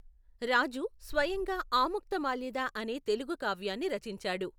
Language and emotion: Telugu, neutral